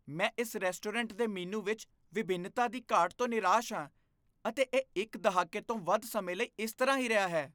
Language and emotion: Punjabi, disgusted